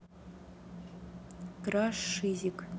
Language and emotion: Russian, neutral